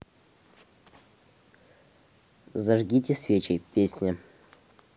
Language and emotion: Russian, neutral